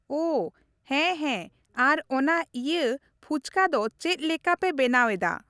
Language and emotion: Santali, neutral